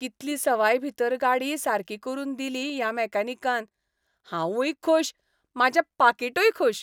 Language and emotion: Goan Konkani, happy